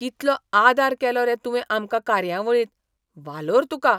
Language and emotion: Goan Konkani, surprised